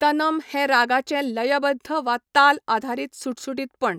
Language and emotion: Goan Konkani, neutral